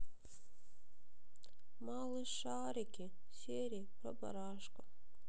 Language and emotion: Russian, sad